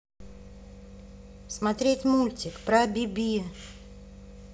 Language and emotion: Russian, angry